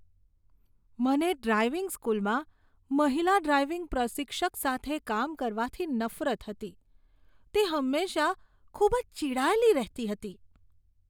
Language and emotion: Gujarati, disgusted